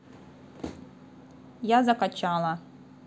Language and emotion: Russian, neutral